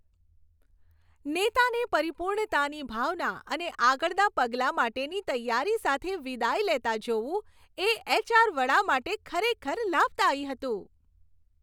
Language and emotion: Gujarati, happy